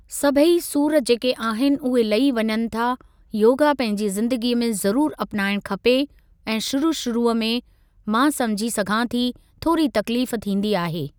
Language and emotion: Sindhi, neutral